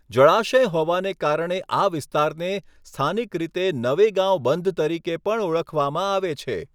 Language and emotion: Gujarati, neutral